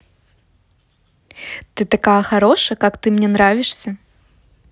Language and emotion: Russian, positive